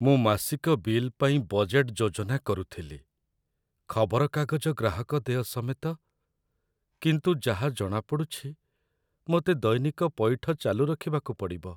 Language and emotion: Odia, sad